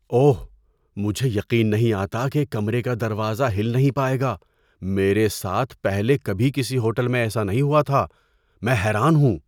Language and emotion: Urdu, surprised